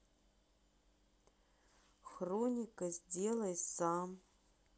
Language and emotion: Russian, neutral